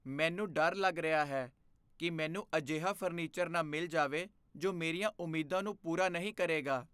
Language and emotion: Punjabi, fearful